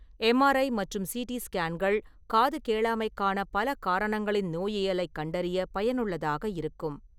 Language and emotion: Tamil, neutral